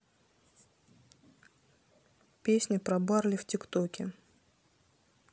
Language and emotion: Russian, neutral